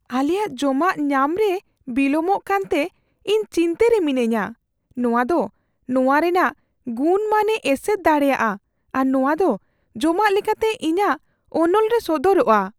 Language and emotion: Santali, fearful